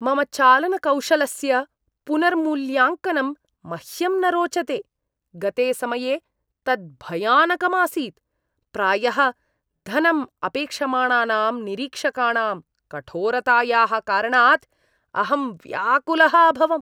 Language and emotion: Sanskrit, disgusted